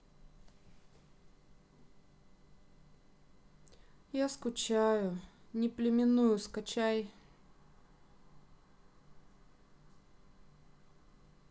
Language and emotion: Russian, sad